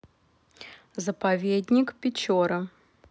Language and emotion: Russian, neutral